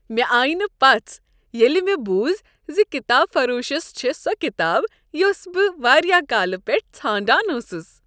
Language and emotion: Kashmiri, happy